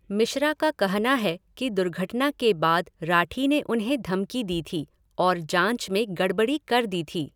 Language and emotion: Hindi, neutral